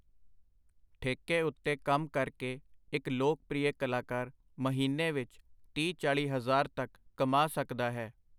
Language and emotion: Punjabi, neutral